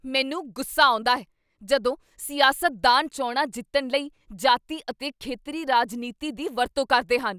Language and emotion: Punjabi, angry